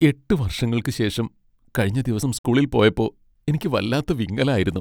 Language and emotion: Malayalam, sad